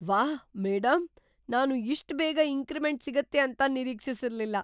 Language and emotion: Kannada, surprised